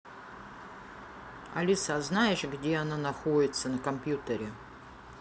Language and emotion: Russian, neutral